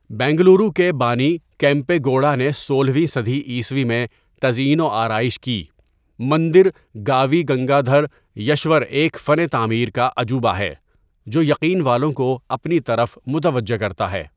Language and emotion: Urdu, neutral